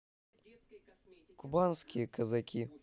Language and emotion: Russian, neutral